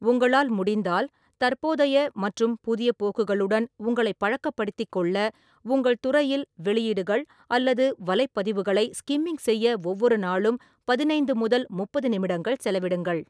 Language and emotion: Tamil, neutral